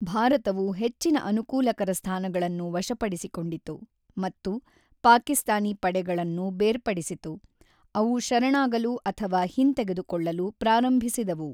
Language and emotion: Kannada, neutral